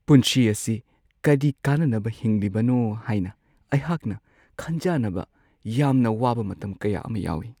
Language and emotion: Manipuri, sad